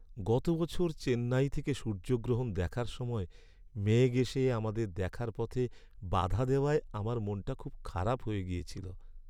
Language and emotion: Bengali, sad